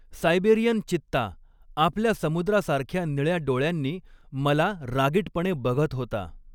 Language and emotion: Marathi, neutral